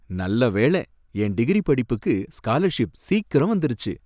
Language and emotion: Tamil, happy